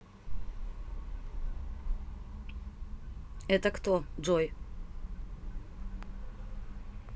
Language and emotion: Russian, neutral